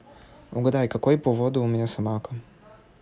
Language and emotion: Russian, neutral